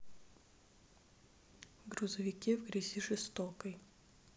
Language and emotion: Russian, neutral